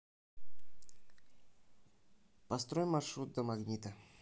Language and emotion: Russian, neutral